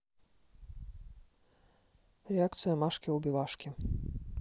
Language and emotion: Russian, neutral